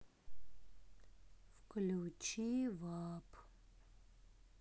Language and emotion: Russian, sad